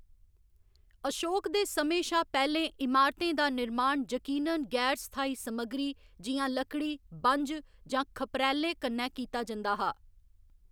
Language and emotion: Dogri, neutral